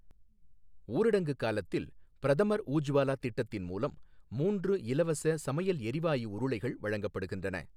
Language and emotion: Tamil, neutral